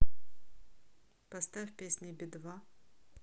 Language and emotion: Russian, neutral